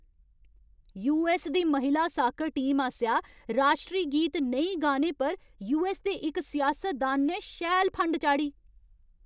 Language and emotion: Dogri, angry